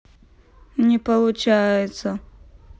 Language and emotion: Russian, sad